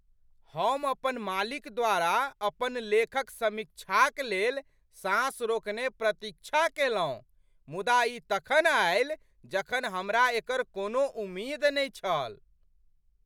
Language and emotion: Maithili, surprised